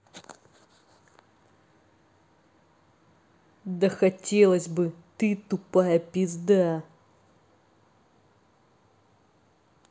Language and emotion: Russian, angry